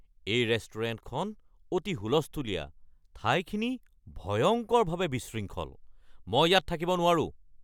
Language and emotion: Assamese, angry